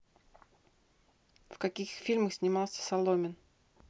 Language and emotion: Russian, neutral